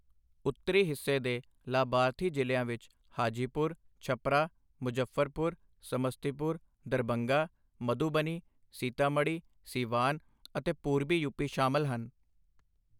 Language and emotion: Punjabi, neutral